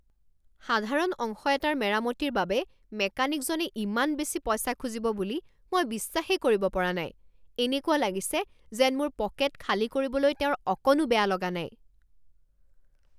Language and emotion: Assamese, angry